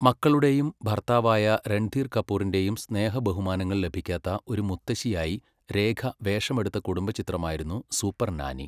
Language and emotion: Malayalam, neutral